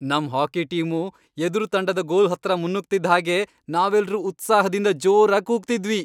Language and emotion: Kannada, happy